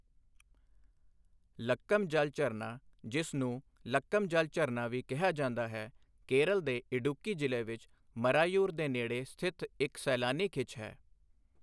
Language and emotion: Punjabi, neutral